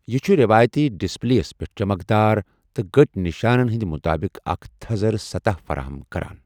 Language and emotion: Kashmiri, neutral